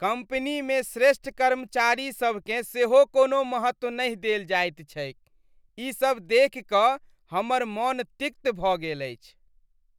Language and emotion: Maithili, disgusted